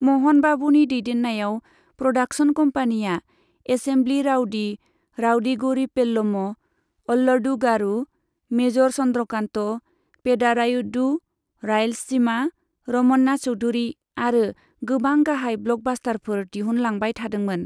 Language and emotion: Bodo, neutral